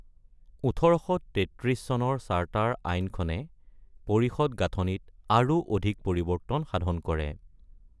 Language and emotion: Assamese, neutral